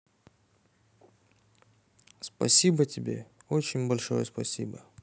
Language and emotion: Russian, neutral